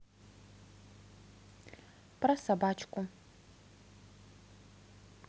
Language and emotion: Russian, neutral